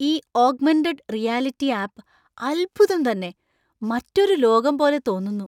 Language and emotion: Malayalam, surprised